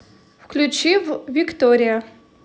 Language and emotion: Russian, neutral